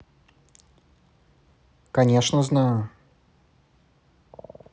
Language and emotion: Russian, neutral